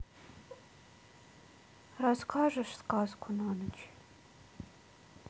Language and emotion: Russian, sad